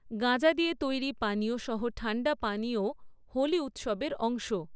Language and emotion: Bengali, neutral